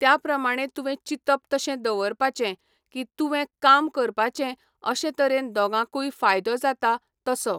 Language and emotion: Goan Konkani, neutral